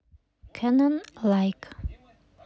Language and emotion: Russian, neutral